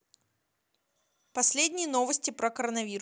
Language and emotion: Russian, neutral